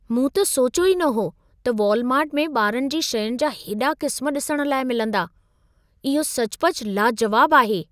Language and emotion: Sindhi, surprised